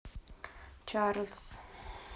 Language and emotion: Russian, neutral